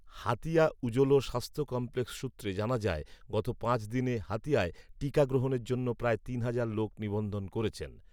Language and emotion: Bengali, neutral